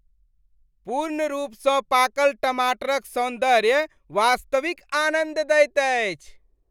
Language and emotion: Maithili, happy